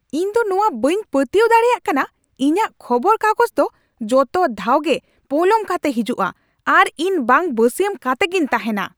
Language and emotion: Santali, angry